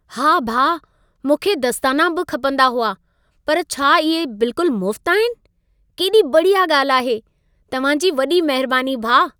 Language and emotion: Sindhi, happy